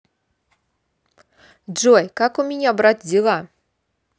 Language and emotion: Russian, positive